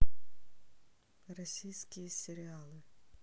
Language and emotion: Russian, neutral